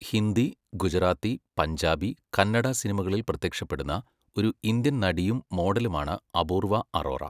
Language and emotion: Malayalam, neutral